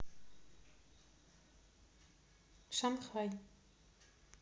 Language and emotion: Russian, neutral